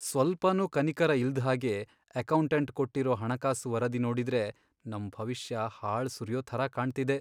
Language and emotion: Kannada, sad